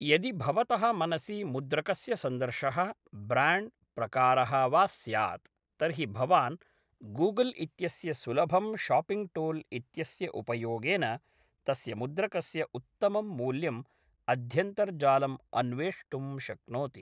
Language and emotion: Sanskrit, neutral